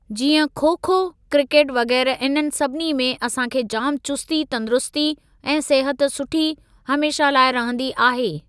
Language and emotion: Sindhi, neutral